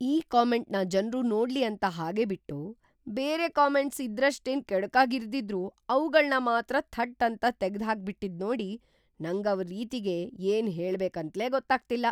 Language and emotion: Kannada, surprised